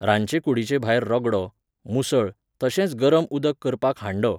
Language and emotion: Goan Konkani, neutral